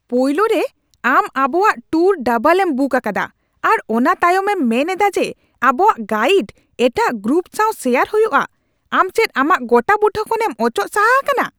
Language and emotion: Santali, angry